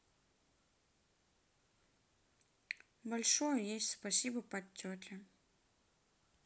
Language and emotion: Russian, sad